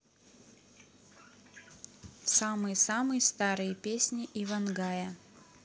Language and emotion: Russian, neutral